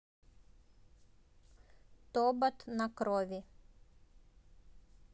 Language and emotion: Russian, neutral